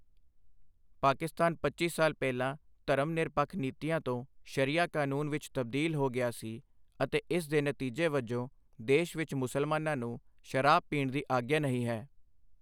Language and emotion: Punjabi, neutral